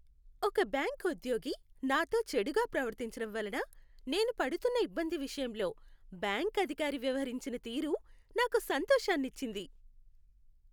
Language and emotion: Telugu, happy